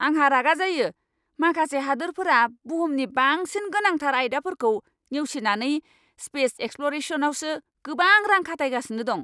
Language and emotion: Bodo, angry